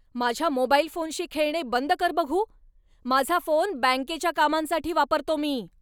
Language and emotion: Marathi, angry